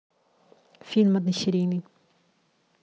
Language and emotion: Russian, neutral